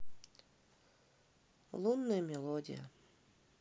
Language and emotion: Russian, neutral